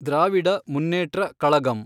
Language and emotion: Kannada, neutral